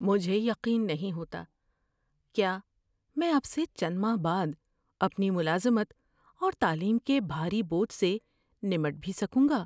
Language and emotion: Urdu, fearful